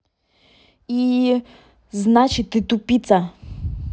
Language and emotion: Russian, angry